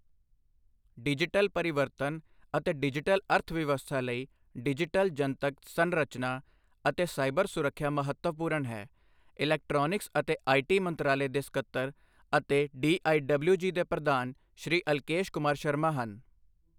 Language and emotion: Punjabi, neutral